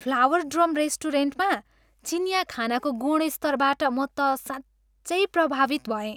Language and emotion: Nepali, happy